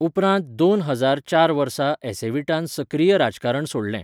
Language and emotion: Goan Konkani, neutral